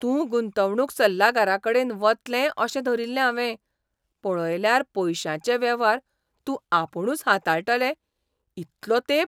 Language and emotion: Goan Konkani, surprised